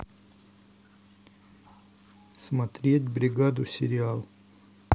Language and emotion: Russian, neutral